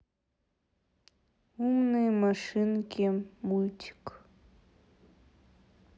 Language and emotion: Russian, sad